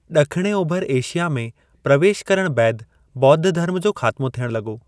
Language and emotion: Sindhi, neutral